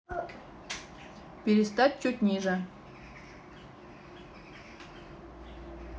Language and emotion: Russian, neutral